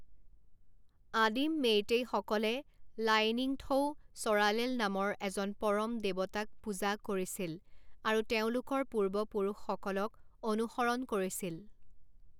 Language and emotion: Assamese, neutral